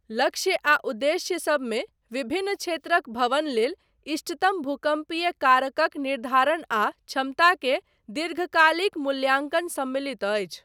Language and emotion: Maithili, neutral